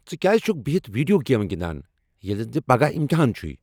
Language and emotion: Kashmiri, angry